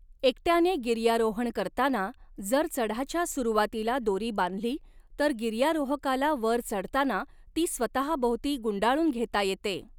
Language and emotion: Marathi, neutral